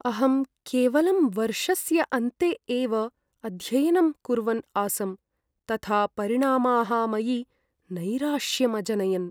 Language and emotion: Sanskrit, sad